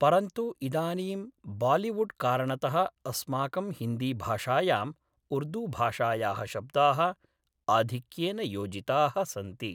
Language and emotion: Sanskrit, neutral